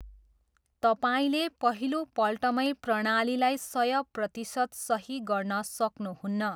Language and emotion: Nepali, neutral